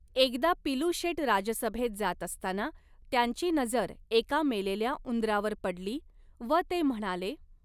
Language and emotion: Marathi, neutral